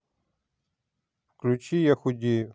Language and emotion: Russian, neutral